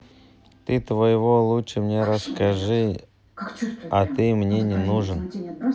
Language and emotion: Russian, neutral